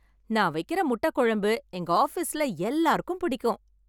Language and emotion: Tamil, happy